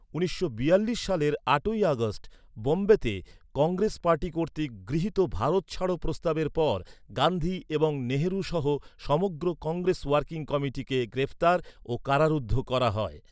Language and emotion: Bengali, neutral